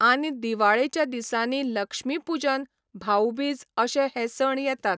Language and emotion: Goan Konkani, neutral